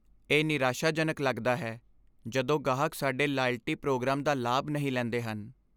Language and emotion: Punjabi, sad